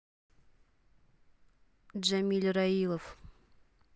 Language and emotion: Russian, neutral